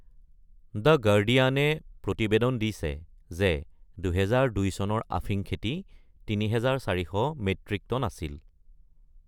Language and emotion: Assamese, neutral